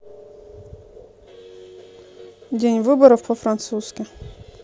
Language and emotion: Russian, neutral